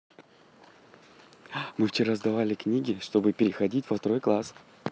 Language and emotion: Russian, positive